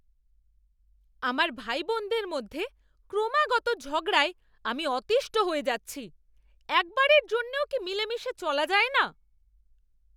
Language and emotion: Bengali, angry